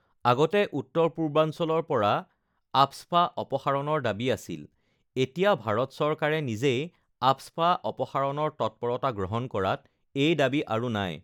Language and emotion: Assamese, neutral